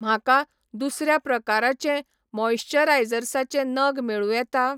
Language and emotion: Goan Konkani, neutral